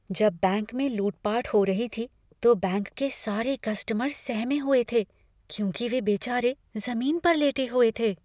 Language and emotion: Hindi, fearful